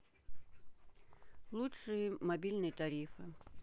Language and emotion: Russian, neutral